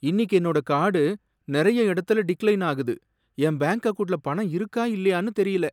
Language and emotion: Tamil, sad